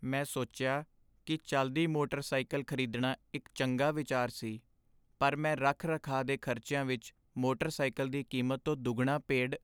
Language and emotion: Punjabi, sad